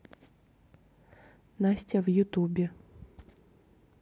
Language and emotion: Russian, neutral